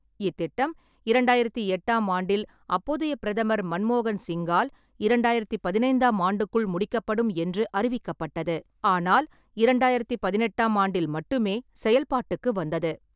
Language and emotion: Tamil, neutral